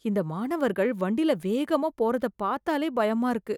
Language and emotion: Tamil, fearful